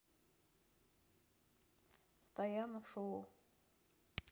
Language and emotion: Russian, neutral